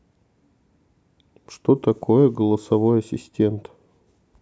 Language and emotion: Russian, neutral